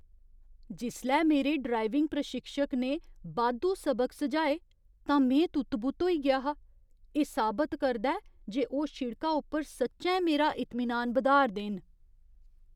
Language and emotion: Dogri, surprised